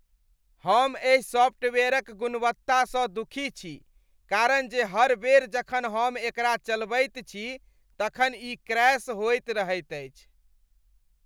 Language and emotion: Maithili, disgusted